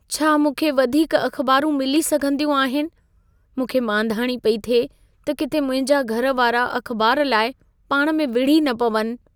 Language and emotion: Sindhi, fearful